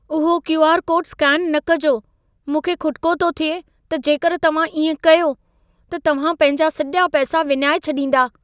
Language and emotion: Sindhi, fearful